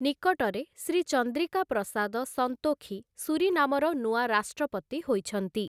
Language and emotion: Odia, neutral